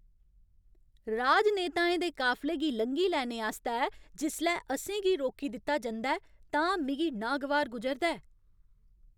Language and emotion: Dogri, angry